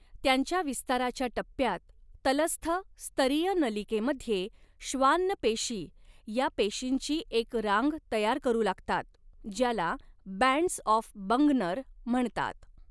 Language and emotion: Marathi, neutral